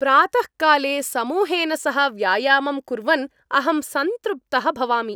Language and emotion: Sanskrit, happy